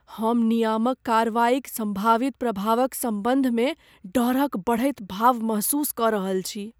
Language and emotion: Maithili, fearful